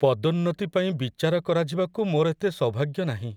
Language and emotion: Odia, sad